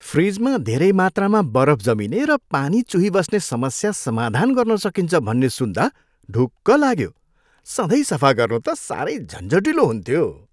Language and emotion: Nepali, happy